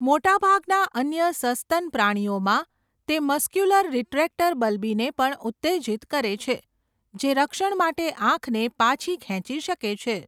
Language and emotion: Gujarati, neutral